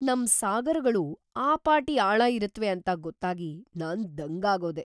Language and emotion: Kannada, surprised